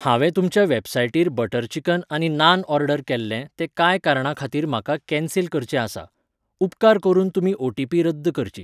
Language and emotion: Goan Konkani, neutral